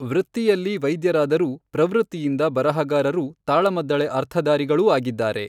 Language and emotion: Kannada, neutral